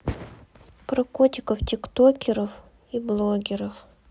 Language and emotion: Russian, sad